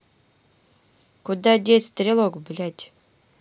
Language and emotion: Russian, neutral